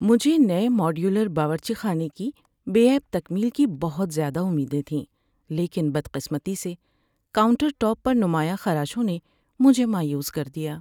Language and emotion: Urdu, sad